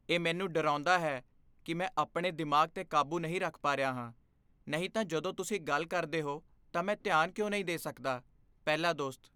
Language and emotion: Punjabi, fearful